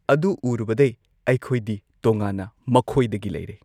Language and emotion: Manipuri, neutral